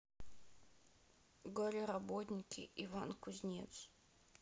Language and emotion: Russian, sad